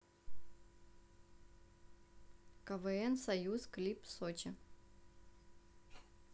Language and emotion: Russian, neutral